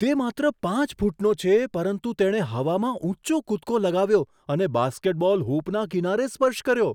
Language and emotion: Gujarati, surprised